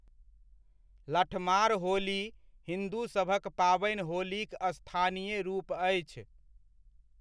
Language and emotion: Maithili, neutral